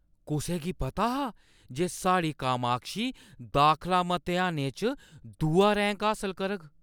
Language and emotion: Dogri, surprised